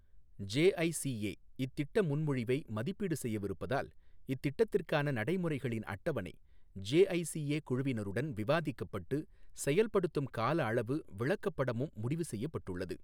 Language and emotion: Tamil, neutral